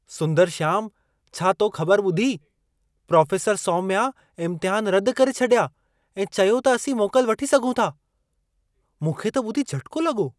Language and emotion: Sindhi, surprised